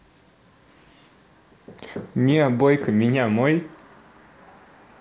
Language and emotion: Russian, positive